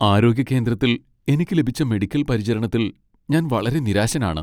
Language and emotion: Malayalam, sad